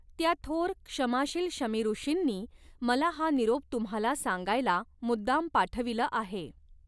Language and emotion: Marathi, neutral